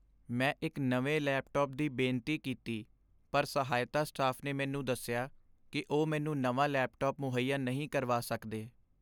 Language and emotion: Punjabi, sad